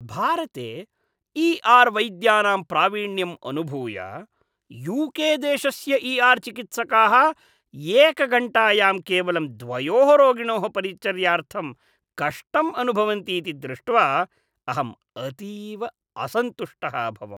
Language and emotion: Sanskrit, disgusted